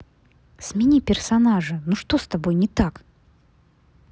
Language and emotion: Russian, angry